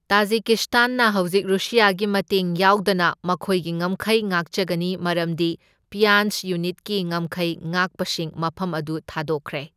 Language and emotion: Manipuri, neutral